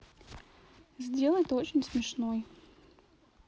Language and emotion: Russian, neutral